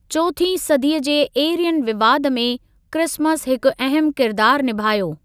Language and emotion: Sindhi, neutral